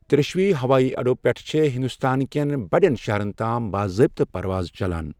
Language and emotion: Kashmiri, neutral